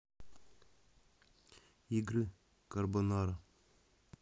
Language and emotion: Russian, neutral